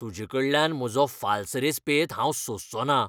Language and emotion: Goan Konkani, angry